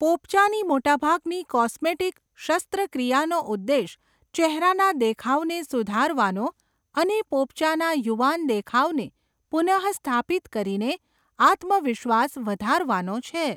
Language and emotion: Gujarati, neutral